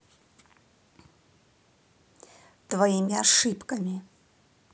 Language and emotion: Russian, angry